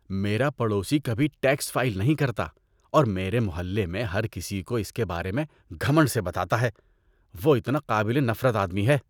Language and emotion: Urdu, disgusted